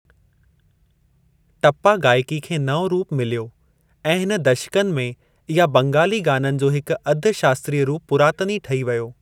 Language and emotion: Sindhi, neutral